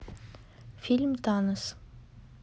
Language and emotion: Russian, neutral